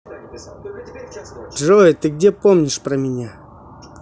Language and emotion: Russian, neutral